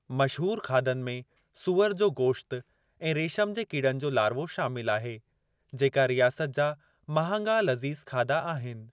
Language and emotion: Sindhi, neutral